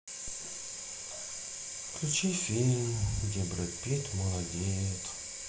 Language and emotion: Russian, sad